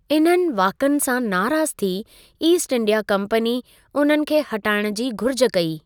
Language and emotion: Sindhi, neutral